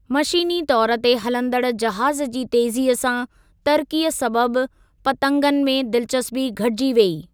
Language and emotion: Sindhi, neutral